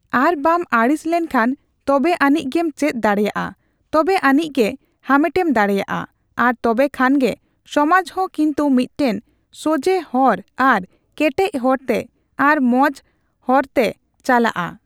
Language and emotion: Santali, neutral